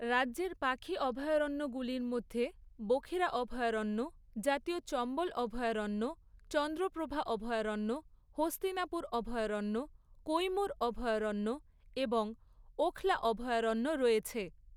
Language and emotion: Bengali, neutral